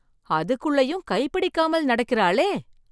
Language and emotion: Tamil, surprised